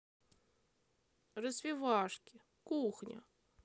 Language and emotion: Russian, positive